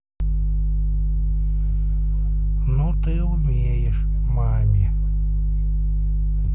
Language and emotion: Russian, neutral